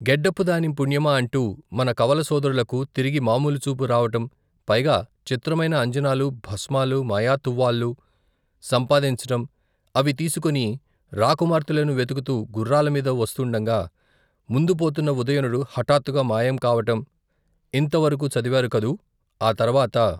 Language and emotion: Telugu, neutral